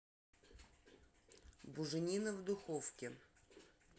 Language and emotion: Russian, neutral